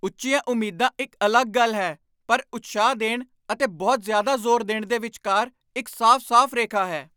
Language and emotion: Punjabi, angry